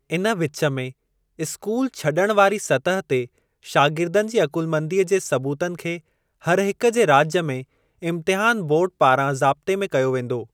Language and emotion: Sindhi, neutral